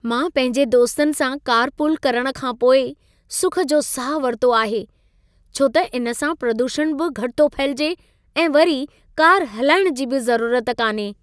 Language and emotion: Sindhi, happy